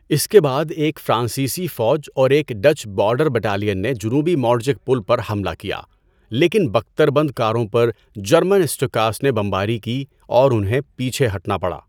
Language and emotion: Urdu, neutral